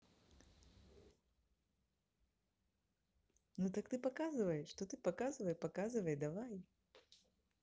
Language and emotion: Russian, positive